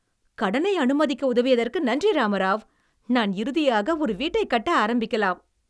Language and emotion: Tamil, happy